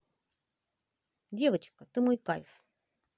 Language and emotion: Russian, positive